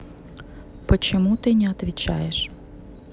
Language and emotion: Russian, neutral